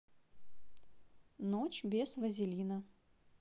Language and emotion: Russian, neutral